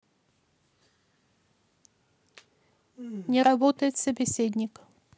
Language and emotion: Russian, neutral